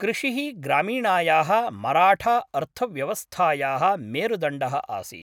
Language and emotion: Sanskrit, neutral